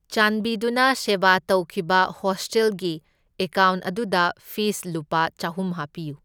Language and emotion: Manipuri, neutral